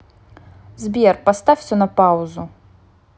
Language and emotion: Russian, neutral